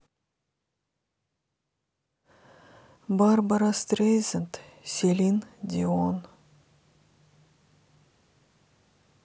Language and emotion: Russian, sad